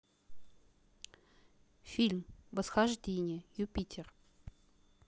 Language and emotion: Russian, neutral